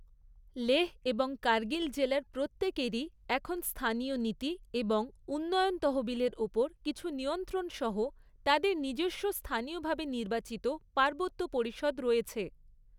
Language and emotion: Bengali, neutral